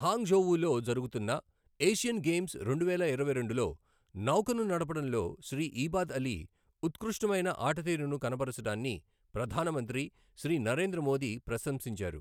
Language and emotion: Telugu, neutral